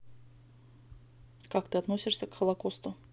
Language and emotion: Russian, neutral